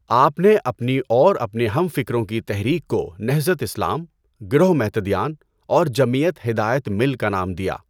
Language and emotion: Urdu, neutral